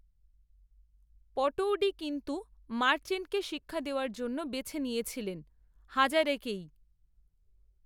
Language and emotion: Bengali, neutral